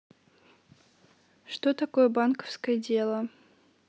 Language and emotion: Russian, neutral